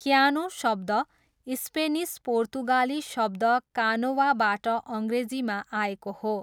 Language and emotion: Nepali, neutral